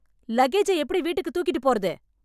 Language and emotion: Tamil, angry